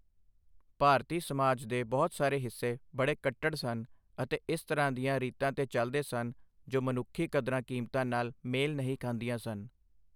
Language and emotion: Punjabi, neutral